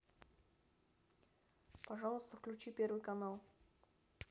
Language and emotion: Russian, neutral